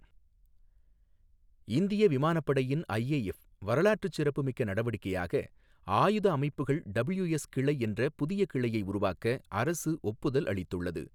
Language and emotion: Tamil, neutral